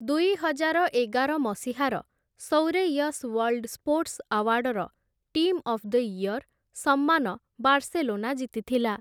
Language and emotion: Odia, neutral